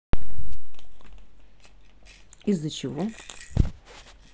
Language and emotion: Russian, neutral